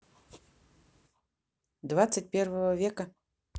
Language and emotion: Russian, neutral